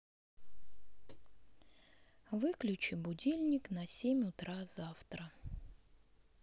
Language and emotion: Russian, sad